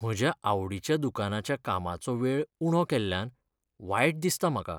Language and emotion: Goan Konkani, sad